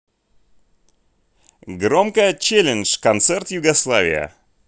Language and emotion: Russian, positive